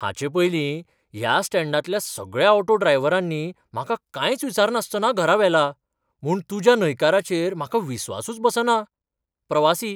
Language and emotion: Goan Konkani, surprised